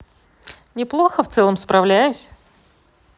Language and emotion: Russian, neutral